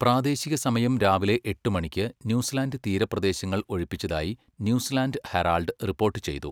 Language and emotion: Malayalam, neutral